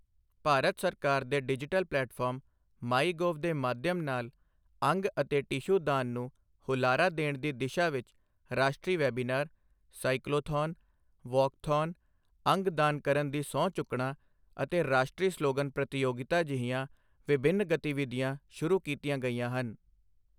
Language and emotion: Punjabi, neutral